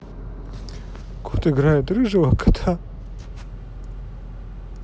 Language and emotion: Russian, positive